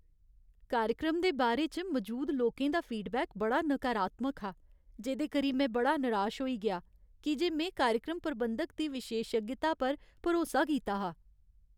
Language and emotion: Dogri, sad